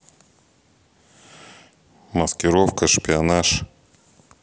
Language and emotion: Russian, neutral